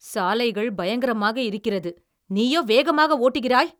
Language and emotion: Tamil, angry